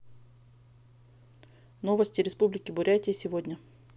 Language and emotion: Russian, neutral